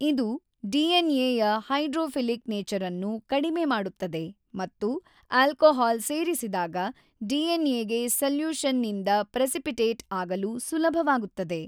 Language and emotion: Kannada, neutral